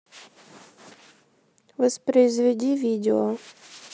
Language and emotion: Russian, neutral